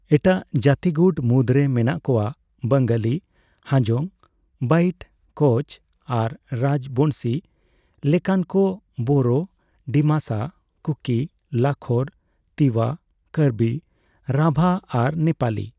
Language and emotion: Santali, neutral